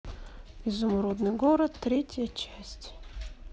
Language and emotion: Russian, neutral